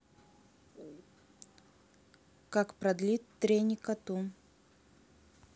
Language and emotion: Russian, neutral